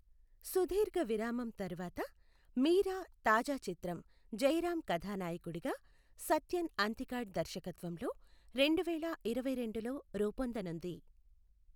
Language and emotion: Telugu, neutral